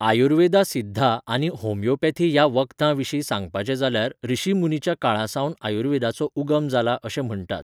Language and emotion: Goan Konkani, neutral